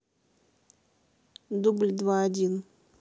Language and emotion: Russian, neutral